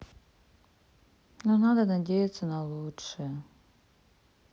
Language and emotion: Russian, sad